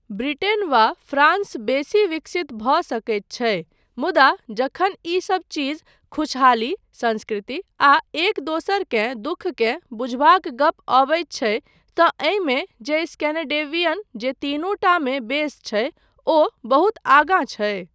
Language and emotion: Maithili, neutral